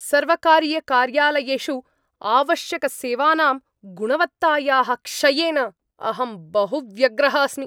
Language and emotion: Sanskrit, angry